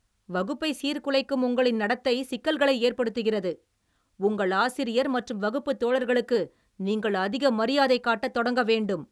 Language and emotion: Tamil, angry